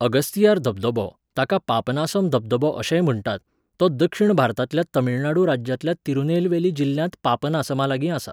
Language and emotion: Goan Konkani, neutral